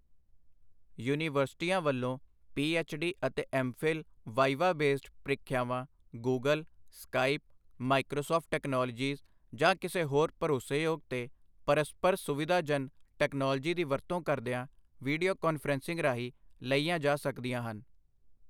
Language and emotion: Punjabi, neutral